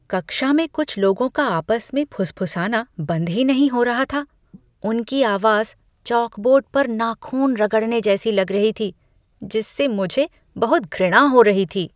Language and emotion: Hindi, disgusted